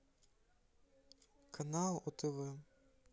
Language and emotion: Russian, neutral